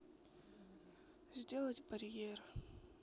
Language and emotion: Russian, sad